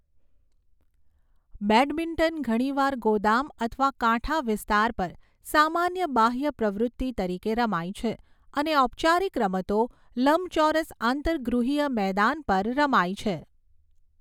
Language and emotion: Gujarati, neutral